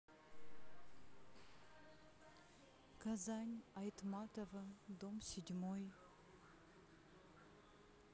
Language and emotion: Russian, neutral